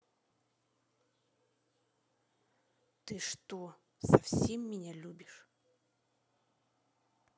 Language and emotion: Russian, angry